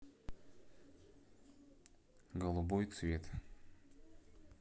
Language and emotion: Russian, neutral